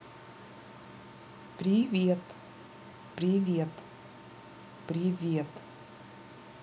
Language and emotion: Russian, neutral